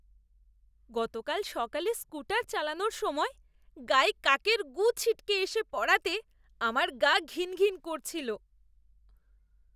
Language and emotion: Bengali, disgusted